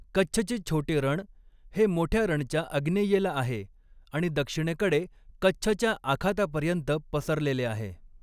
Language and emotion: Marathi, neutral